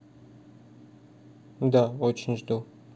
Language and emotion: Russian, neutral